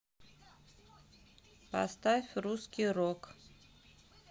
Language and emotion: Russian, neutral